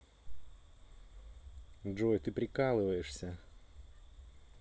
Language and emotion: Russian, positive